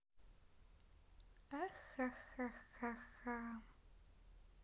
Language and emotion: Russian, neutral